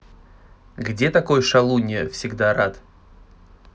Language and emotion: Russian, neutral